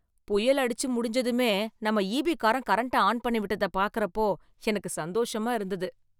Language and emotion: Tamil, happy